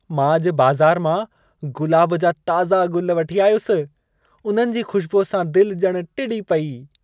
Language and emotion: Sindhi, happy